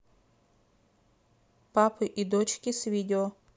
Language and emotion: Russian, neutral